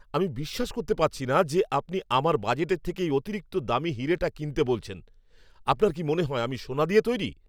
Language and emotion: Bengali, angry